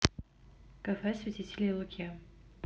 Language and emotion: Russian, neutral